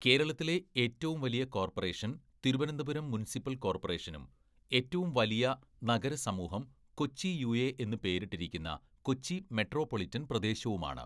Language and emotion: Malayalam, neutral